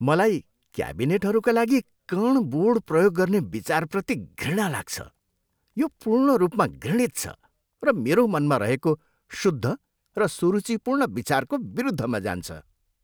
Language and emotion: Nepali, disgusted